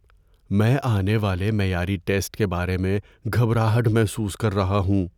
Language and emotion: Urdu, fearful